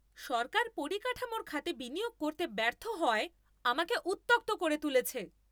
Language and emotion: Bengali, angry